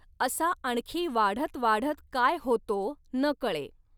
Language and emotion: Marathi, neutral